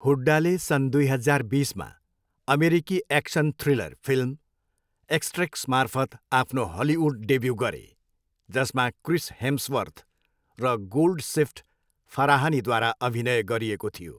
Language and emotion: Nepali, neutral